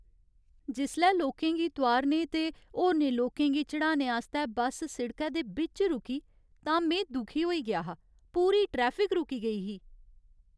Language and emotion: Dogri, sad